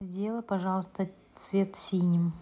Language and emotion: Russian, neutral